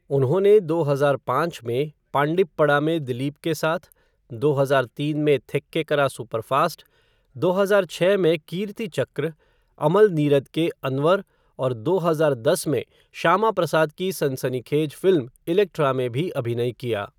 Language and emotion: Hindi, neutral